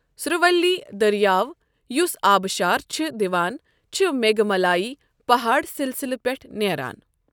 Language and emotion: Kashmiri, neutral